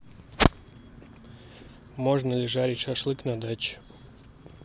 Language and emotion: Russian, neutral